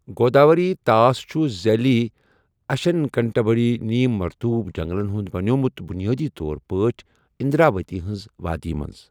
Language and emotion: Kashmiri, neutral